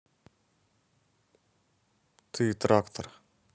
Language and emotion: Russian, neutral